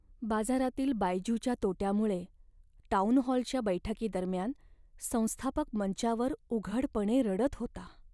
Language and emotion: Marathi, sad